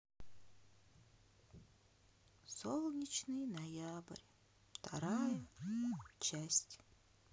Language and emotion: Russian, sad